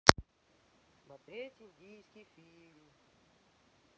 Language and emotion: Russian, neutral